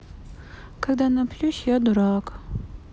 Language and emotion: Russian, sad